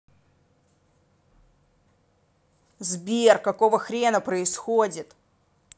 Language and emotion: Russian, angry